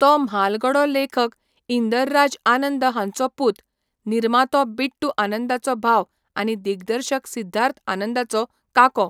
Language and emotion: Goan Konkani, neutral